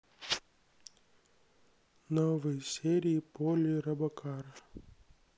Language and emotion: Russian, sad